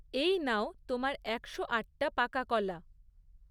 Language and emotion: Bengali, neutral